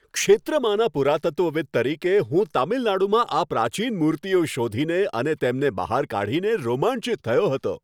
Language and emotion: Gujarati, happy